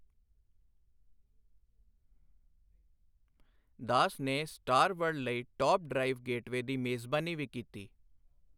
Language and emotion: Punjabi, neutral